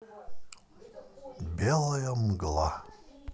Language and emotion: Russian, neutral